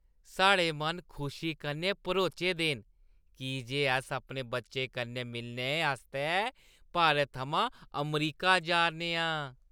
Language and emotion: Dogri, happy